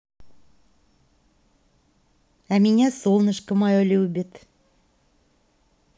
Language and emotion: Russian, positive